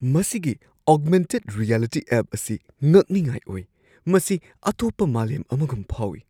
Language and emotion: Manipuri, surprised